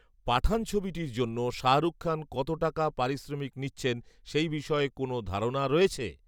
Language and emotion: Bengali, neutral